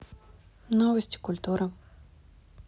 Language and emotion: Russian, neutral